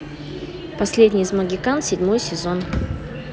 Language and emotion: Russian, positive